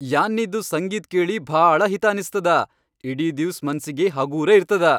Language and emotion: Kannada, happy